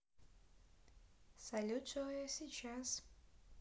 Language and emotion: Russian, neutral